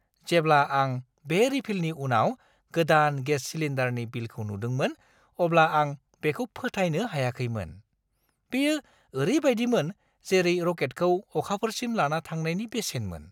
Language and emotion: Bodo, surprised